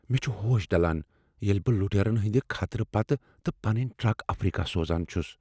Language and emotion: Kashmiri, fearful